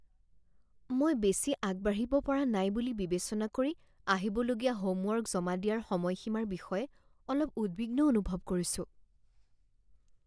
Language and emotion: Assamese, fearful